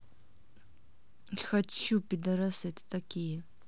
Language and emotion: Russian, angry